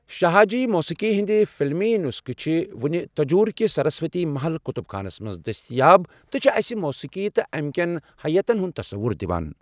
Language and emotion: Kashmiri, neutral